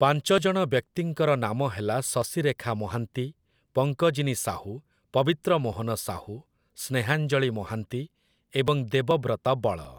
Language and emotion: Odia, neutral